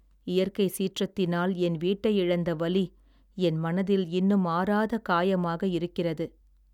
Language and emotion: Tamil, sad